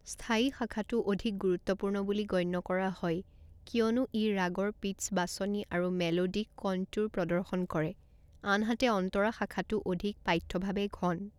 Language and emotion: Assamese, neutral